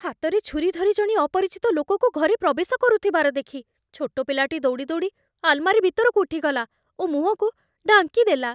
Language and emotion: Odia, fearful